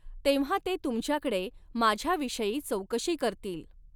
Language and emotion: Marathi, neutral